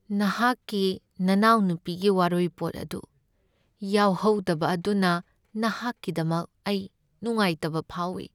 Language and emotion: Manipuri, sad